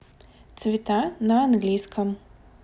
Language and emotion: Russian, neutral